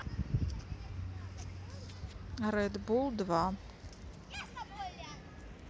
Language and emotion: Russian, neutral